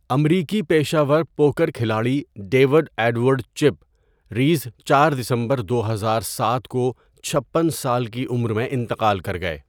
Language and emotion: Urdu, neutral